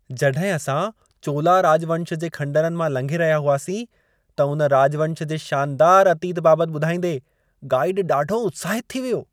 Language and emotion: Sindhi, happy